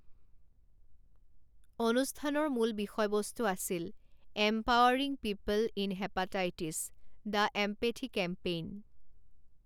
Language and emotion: Assamese, neutral